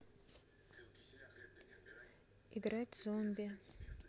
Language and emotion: Russian, neutral